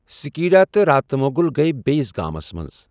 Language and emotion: Kashmiri, neutral